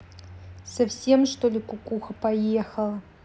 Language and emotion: Russian, angry